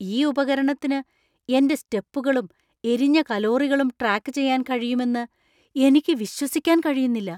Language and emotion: Malayalam, surprised